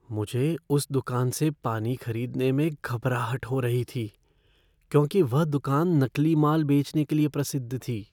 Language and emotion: Hindi, fearful